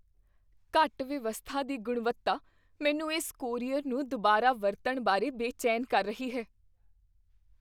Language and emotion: Punjabi, fearful